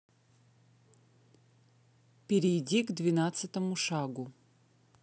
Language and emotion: Russian, neutral